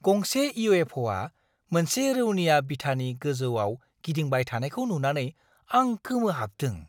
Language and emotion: Bodo, surprised